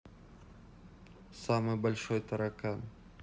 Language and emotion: Russian, neutral